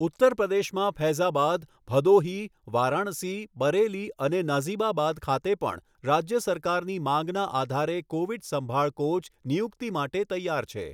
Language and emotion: Gujarati, neutral